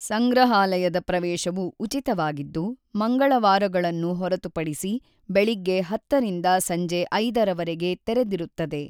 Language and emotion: Kannada, neutral